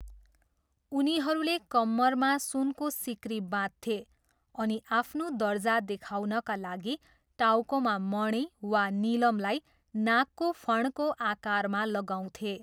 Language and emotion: Nepali, neutral